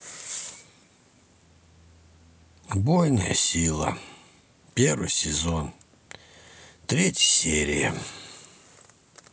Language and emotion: Russian, sad